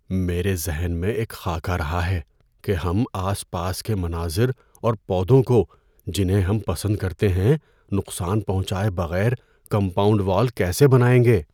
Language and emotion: Urdu, fearful